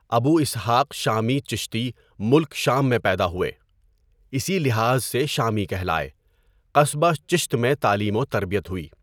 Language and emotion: Urdu, neutral